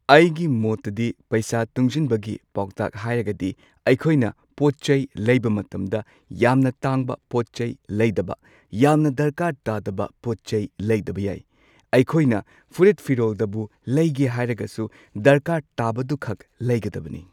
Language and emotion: Manipuri, neutral